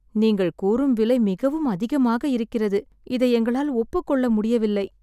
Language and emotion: Tamil, sad